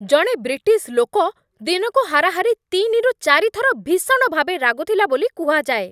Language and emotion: Odia, angry